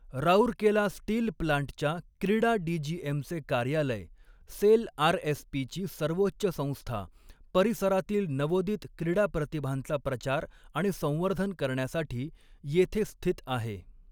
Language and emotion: Marathi, neutral